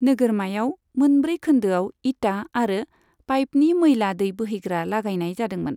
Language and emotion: Bodo, neutral